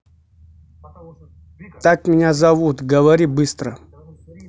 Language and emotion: Russian, angry